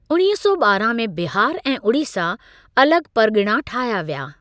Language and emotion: Sindhi, neutral